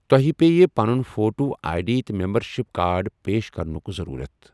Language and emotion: Kashmiri, neutral